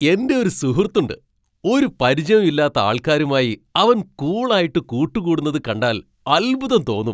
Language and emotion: Malayalam, surprised